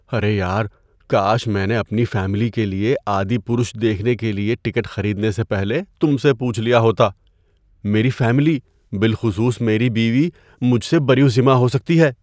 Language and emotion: Urdu, fearful